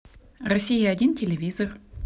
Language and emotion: Russian, neutral